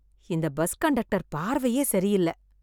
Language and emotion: Tamil, disgusted